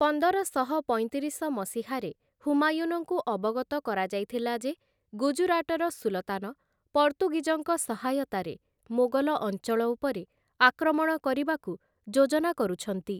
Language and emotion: Odia, neutral